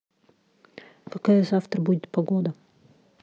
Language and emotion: Russian, neutral